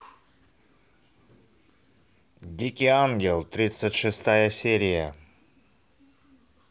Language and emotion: Russian, positive